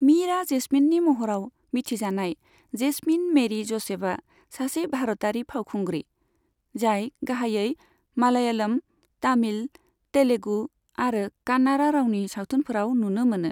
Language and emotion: Bodo, neutral